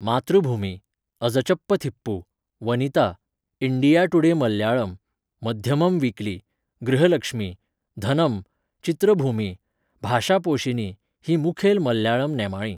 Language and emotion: Goan Konkani, neutral